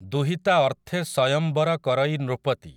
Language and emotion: Odia, neutral